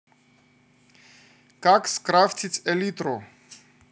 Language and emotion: Russian, neutral